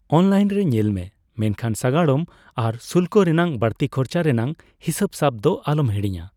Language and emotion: Santali, neutral